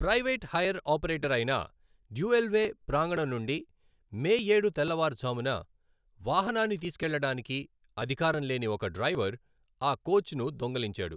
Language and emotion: Telugu, neutral